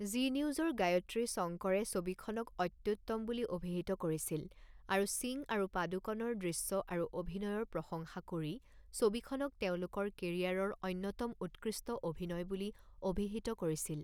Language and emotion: Assamese, neutral